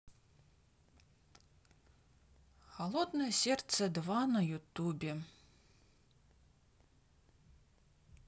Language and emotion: Russian, neutral